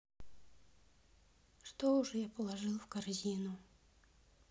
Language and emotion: Russian, sad